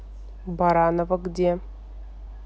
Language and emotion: Russian, neutral